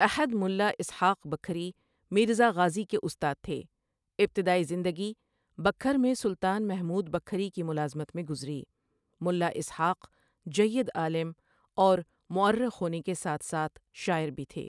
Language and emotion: Urdu, neutral